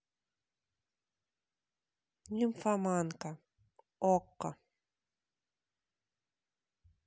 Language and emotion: Russian, neutral